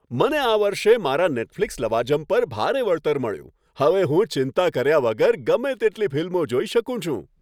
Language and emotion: Gujarati, happy